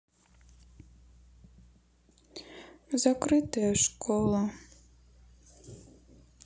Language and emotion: Russian, sad